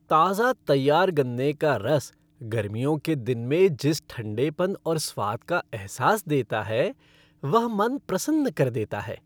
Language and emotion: Hindi, happy